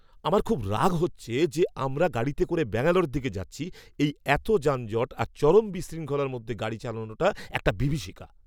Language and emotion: Bengali, angry